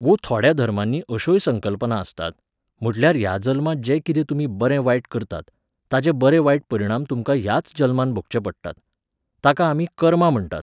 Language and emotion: Goan Konkani, neutral